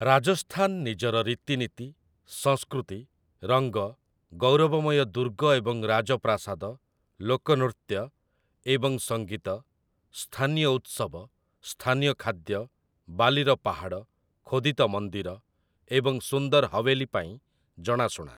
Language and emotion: Odia, neutral